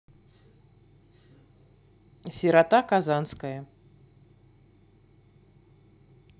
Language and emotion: Russian, neutral